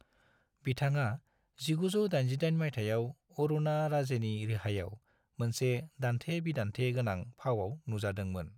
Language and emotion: Bodo, neutral